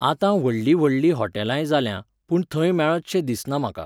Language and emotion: Goan Konkani, neutral